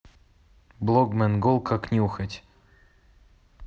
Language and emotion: Russian, neutral